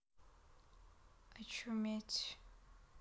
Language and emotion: Russian, sad